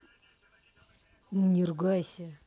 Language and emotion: Russian, angry